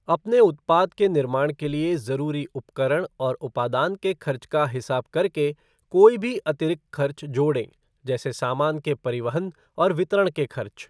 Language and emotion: Hindi, neutral